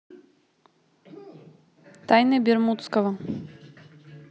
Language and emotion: Russian, neutral